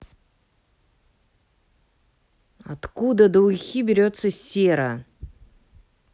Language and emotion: Russian, angry